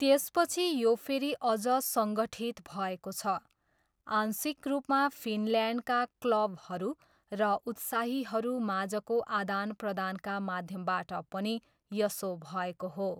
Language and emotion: Nepali, neutral